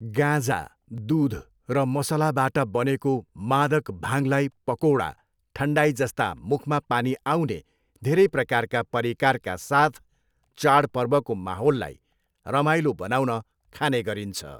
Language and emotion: Nepali, neutral